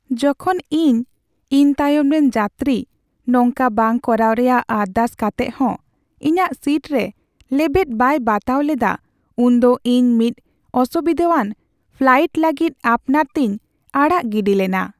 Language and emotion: Santali, sad